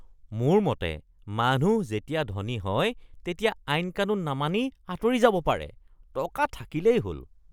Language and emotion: Assamese, disgusted